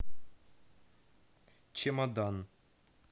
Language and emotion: Russian, neutral